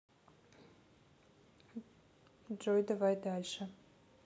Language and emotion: Russian, neutral